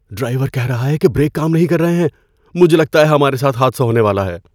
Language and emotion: Urdu, fearful